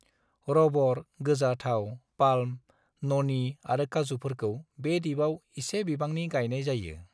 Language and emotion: Bodo, neutral